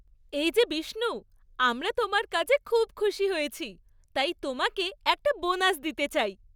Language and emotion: Bengali, happy